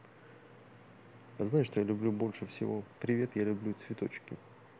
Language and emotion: Russian, neutral